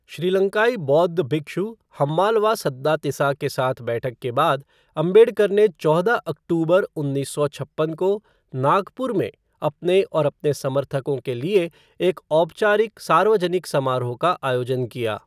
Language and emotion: Hindi, neutral